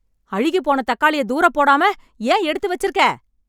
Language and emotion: Tamil, angry